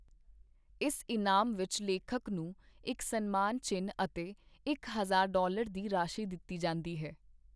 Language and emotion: Punjabi, neutral